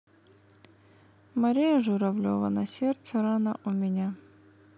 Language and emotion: Russian, sad